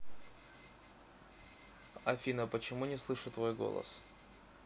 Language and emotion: Russian, neutral